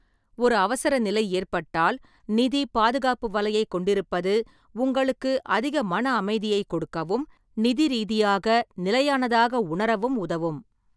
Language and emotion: Tamil, neutral